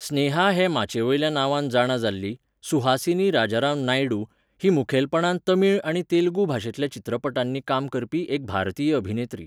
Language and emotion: Goan Konkani, neutral